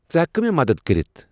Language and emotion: Kashmiri, neutral